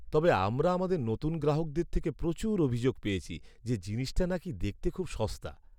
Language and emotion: Bengali, sad